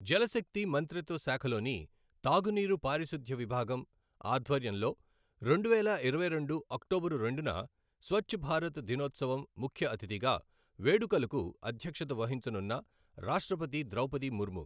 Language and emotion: Telugu, neutral